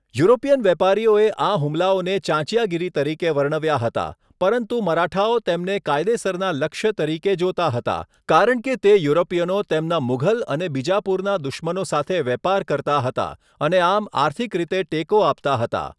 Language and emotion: Gujarati, neutral